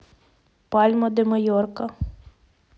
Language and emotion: Russian, neutral